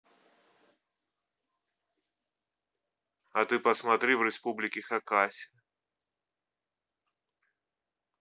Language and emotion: Russian, neutral